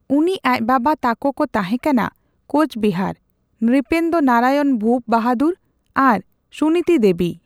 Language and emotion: Santali, neutral